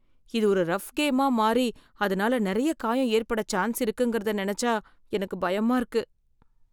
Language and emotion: Tamil, fearful